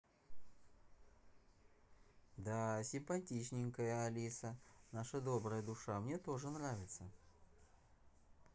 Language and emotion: Russian, positive